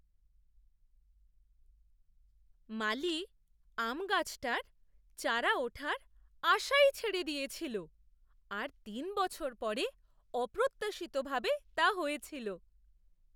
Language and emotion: Bengali, surprised